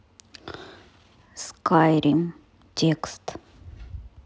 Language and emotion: Russian, neutral